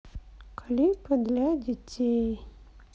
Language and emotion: Russian, sad